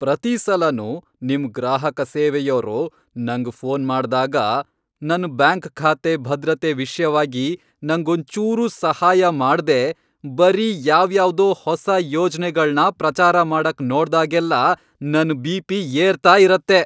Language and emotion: Kannada, angry